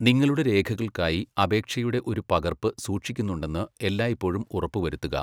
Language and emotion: Malayalam, neutral